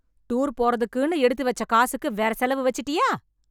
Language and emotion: Tamil, angry